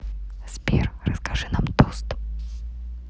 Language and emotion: Russian, neutral